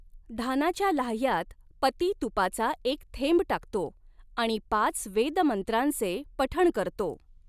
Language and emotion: Marathi, neutral